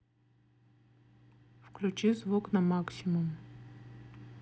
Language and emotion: Russian, neutral